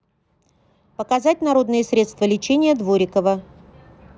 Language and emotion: Russian, neutral